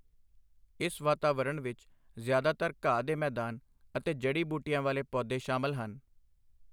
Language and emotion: Punjabi, neutral